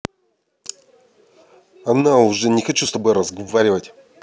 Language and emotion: Russian, angry